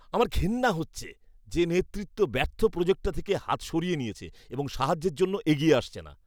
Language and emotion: Bengali, disgusted